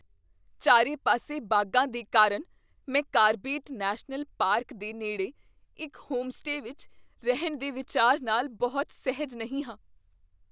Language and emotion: Punjabi, fearful